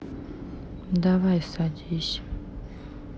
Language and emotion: Russian, sad